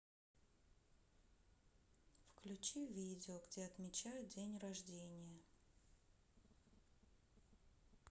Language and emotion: Russian, neutral